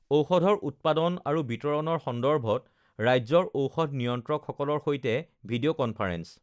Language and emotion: Assamese, neutral